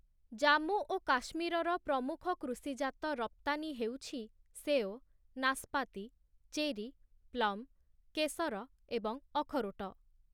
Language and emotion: Odia, neutral